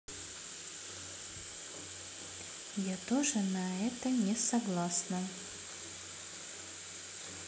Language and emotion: Russian, neutral